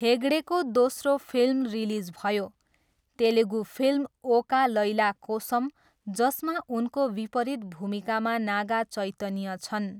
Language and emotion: Nepali, neutral